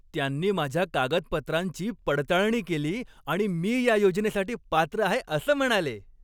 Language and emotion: Marathi, happy